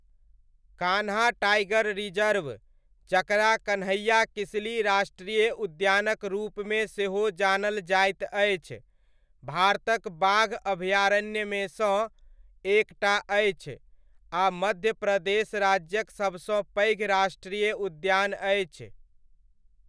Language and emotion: Maithili, neutral